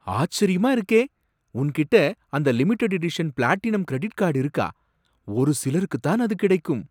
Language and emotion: Tamil, surprised